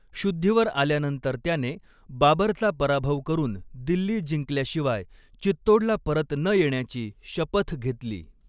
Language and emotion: Marathi, neutral